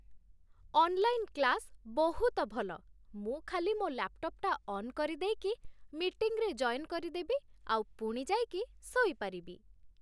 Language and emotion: Odia, happy